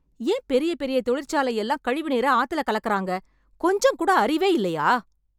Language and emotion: Tamil, angry